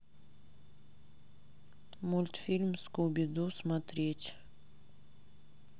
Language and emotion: Russian, neutral